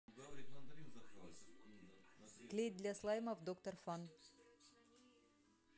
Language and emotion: Russian, neutral